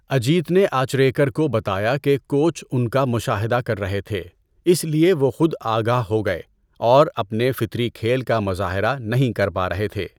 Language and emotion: Urdu, neutral